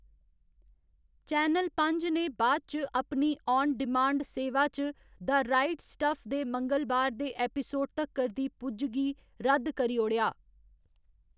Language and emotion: Dogri, neutral